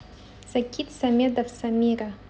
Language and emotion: Russian, neutral